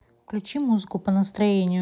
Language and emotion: Russian, neutral